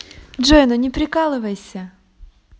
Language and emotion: Russian, positive